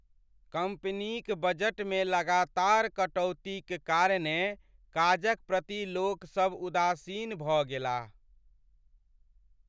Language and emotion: Maithili, sad